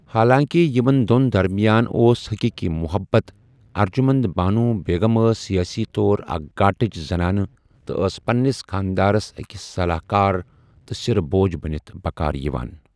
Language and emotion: Kashmiri, neutral